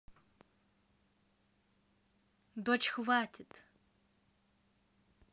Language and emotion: Russian, angry